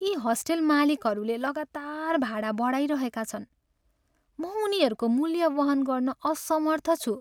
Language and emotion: Nepali, sad